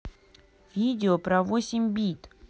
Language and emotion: Russian, neutral